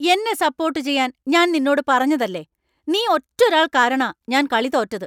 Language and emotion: Malayalam, angry